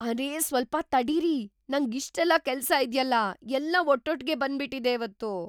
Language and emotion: Kannada, surprised